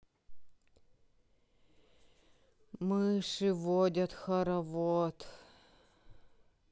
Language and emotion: Russian, sad